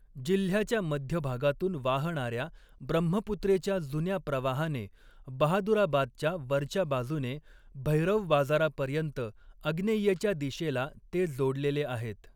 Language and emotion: Marathi, neutral